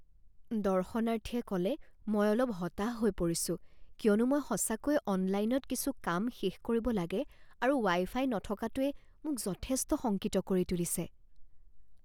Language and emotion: Assamese, fearful